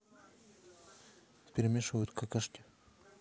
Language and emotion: Russian, neutral